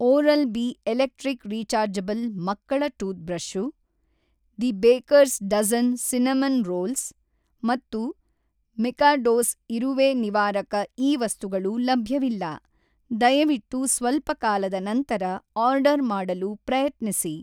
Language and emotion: Kannada, neutral